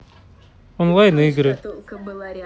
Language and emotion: Russian, neutral